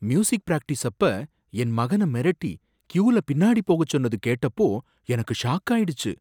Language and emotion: Tamil, surprised